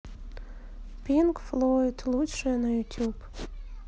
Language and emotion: Russian, sad